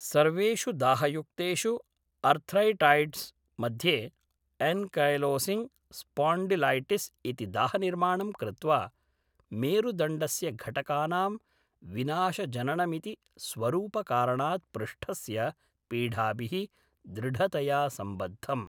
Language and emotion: Sanskrit, neutral